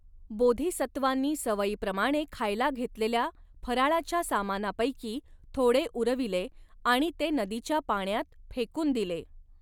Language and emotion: Marathi, neutral